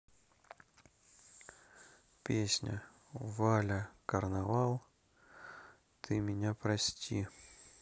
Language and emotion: Russian, neutral